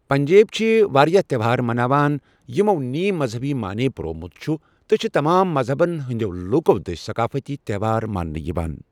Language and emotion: Kashmiri, neutral